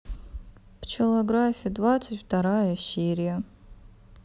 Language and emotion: Russian, sad